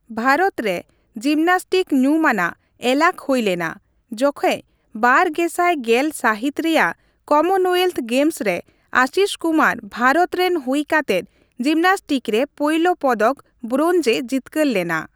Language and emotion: Santali, neutral